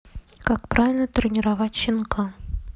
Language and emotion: Russian, neutral